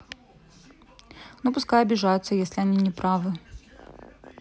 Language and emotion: Russian, neutral